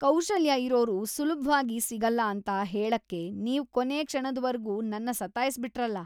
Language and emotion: Kannada, disgusted